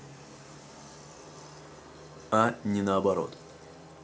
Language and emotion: Russian, neutral